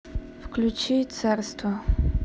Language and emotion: Russian, neutral